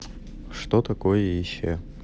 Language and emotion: Russian, neutral